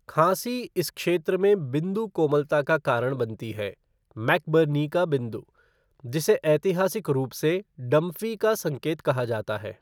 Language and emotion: Hindi, neutral